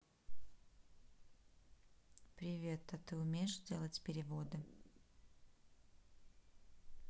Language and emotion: Russian, neutral